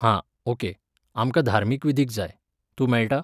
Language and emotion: Goan Konkani, neutral